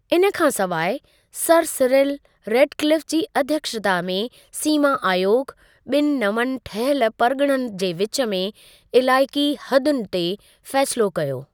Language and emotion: Sindhi, neutral